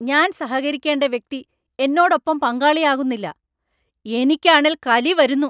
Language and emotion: Malayalam, angry